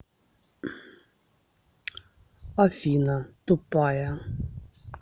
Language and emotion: Russian, neutral